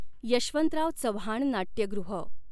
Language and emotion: Marathi, neutral